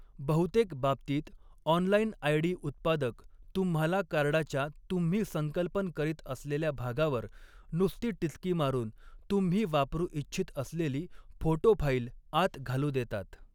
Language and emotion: Marathi, neutral